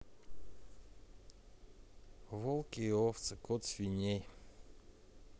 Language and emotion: Russian, neutral